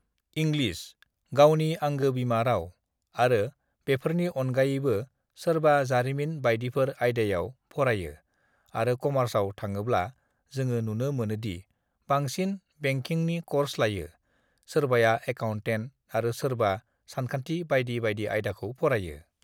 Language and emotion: Bodo, neutral